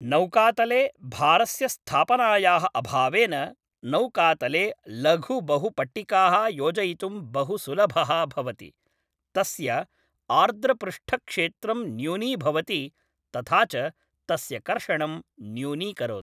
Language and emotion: Sanskrit, neutral